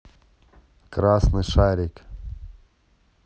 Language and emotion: Russian, neutral